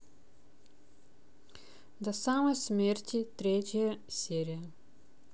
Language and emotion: Russian, neutral